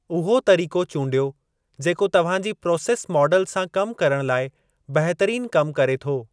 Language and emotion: Sindhi, neutral